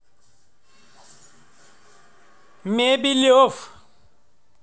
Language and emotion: Russian, positive